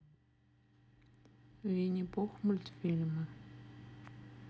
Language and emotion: Russian, sad